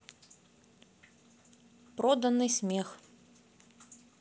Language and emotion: Russian, neutral